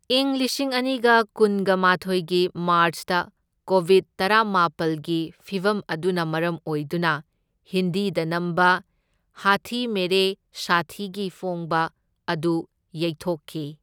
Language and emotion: Manipuri, neutral